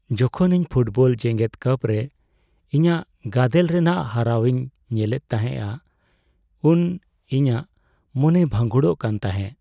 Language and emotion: Santali, sad